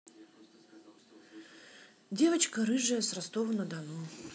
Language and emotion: Russian, neutral